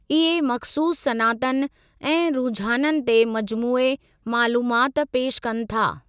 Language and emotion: Sindhi, neutral